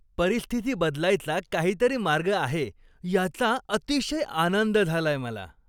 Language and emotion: Marathi, happy